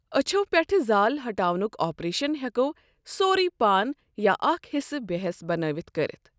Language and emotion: Kashmiri, neutral